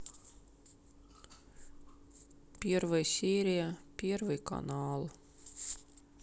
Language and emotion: Russian, sad